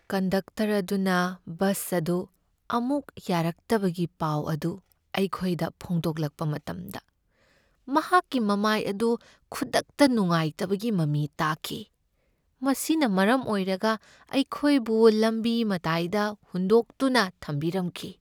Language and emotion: Manipuri, sad